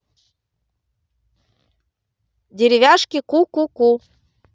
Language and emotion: Russian, positive